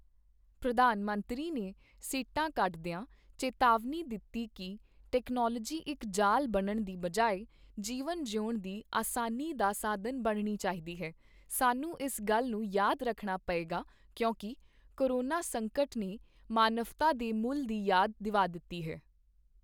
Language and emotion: Punjabi, neutral